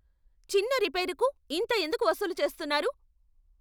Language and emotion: Telugu, angry